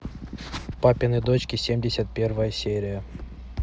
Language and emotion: Russian, neutral